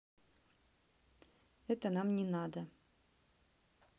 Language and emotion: Russian, neutral